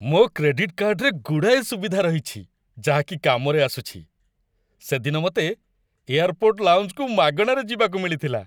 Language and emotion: Odia, happy